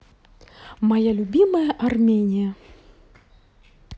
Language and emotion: Russian, positive